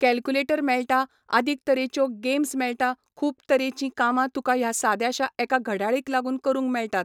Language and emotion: Goan Konkani, neutral